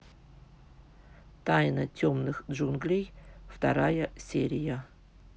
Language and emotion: Russian, neutral